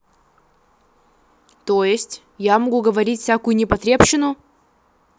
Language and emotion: Russian, angry